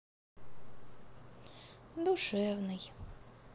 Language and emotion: Russian, sad